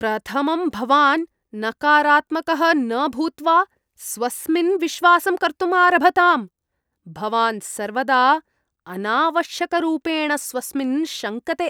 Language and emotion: Sanskrit, disgusted